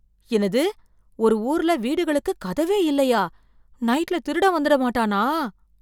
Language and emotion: Tamil, fearful